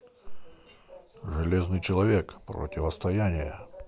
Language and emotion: Russian, neutral